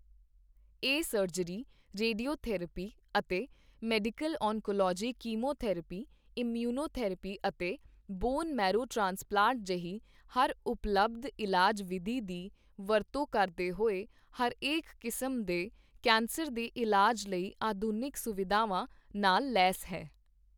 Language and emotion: Punjabi, neutral